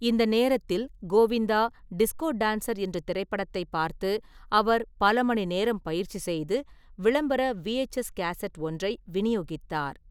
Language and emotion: Tamil, neutral